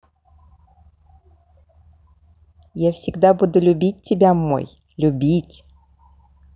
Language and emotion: Russian, positive